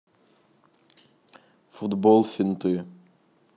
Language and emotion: Russian, neutral